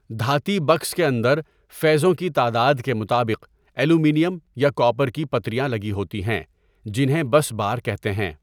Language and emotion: Urdu, neutral